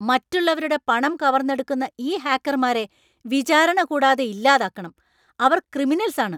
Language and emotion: Malayalam, angry